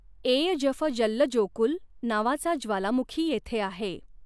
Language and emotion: Marathi, neutral